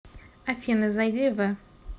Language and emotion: Russian, neutral